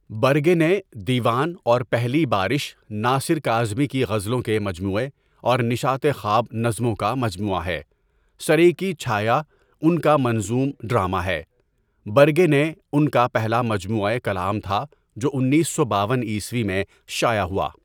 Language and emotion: Urdu, neutral